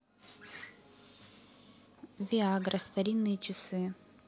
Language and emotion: Russian, neutral